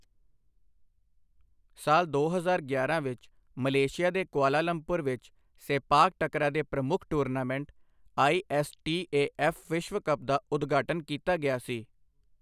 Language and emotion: Punjabi, neutral